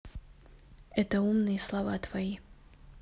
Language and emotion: Russian, neutral